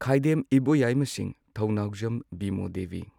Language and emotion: Manipuri, neutral